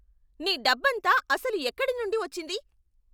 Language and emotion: Telugu, angry